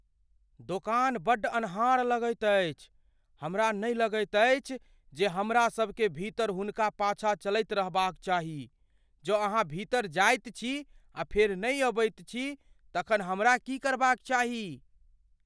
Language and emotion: Maithili, fearful